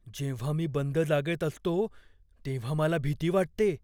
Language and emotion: Marathi, fearful